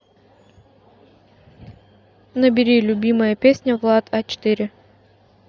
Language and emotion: Russian, neutral